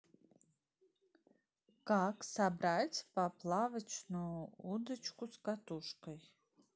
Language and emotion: Russian, neutral